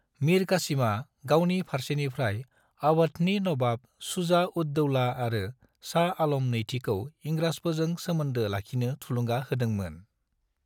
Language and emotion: Bodo, neutral